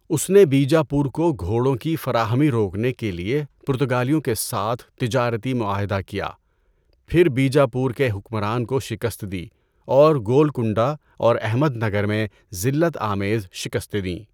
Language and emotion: Urdu, neutral